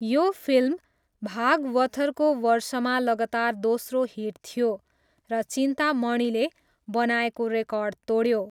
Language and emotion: Nepali, neutral